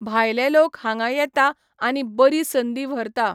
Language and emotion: Goan Konkani, neutral